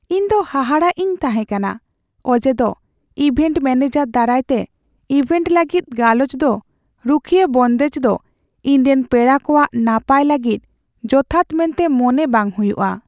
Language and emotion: Santali, sad